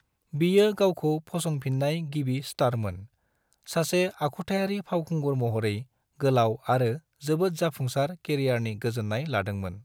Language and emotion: Bodo, neutral